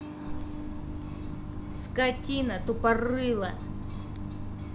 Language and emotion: Russian, angry